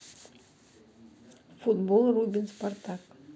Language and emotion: Russian, neutral